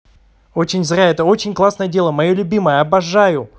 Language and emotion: Russian, positive